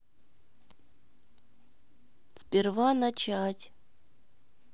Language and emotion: Russian, neutral